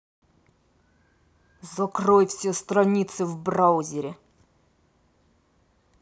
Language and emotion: Russian, angry